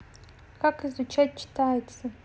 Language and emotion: Russian, neutral